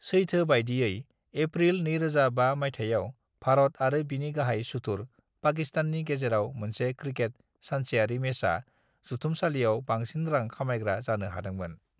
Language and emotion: Bodo, neutral